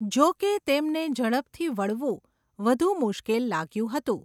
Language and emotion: Gujarati, neutral